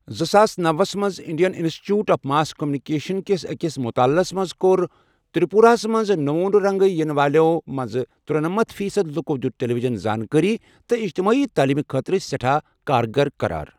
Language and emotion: Kashmiri, neutral